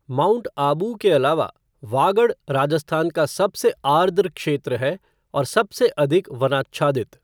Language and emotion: Hindi, neutral